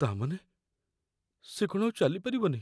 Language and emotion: Odia, fearful